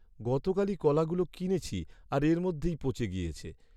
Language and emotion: Bengali, sad